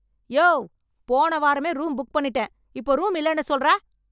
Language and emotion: Tamil, angry